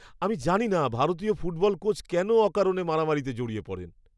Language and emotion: Bengali, disgusted